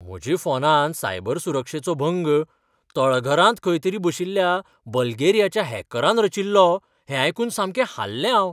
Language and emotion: Goan Konkani, surprised